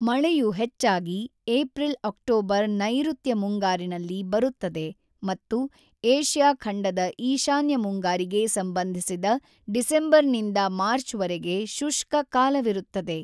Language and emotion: Kannada, neutral